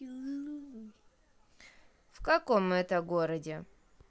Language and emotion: Russian, neutral